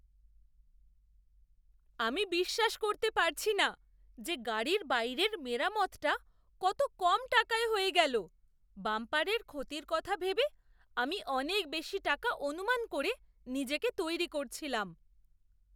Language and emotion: Bengali, surprised